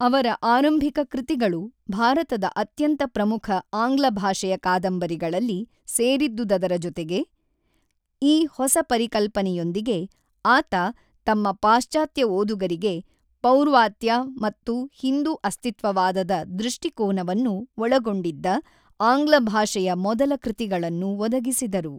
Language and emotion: Kannada, neutral